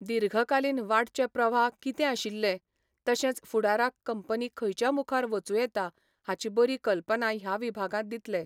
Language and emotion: Goan Konkani, neutral